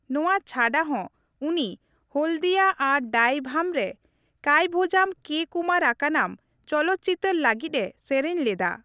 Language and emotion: Santali, neutral